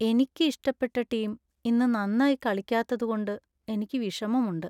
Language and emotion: Malayalam, sad